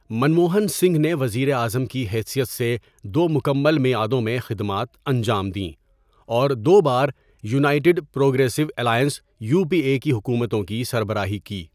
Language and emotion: Urdu, neutral